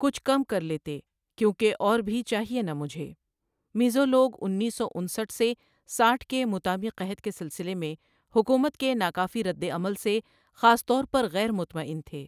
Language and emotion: Urdu, neutral